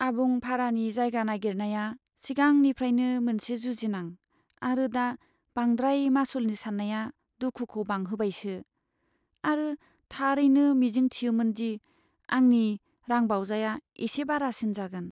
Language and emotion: Bodo, sad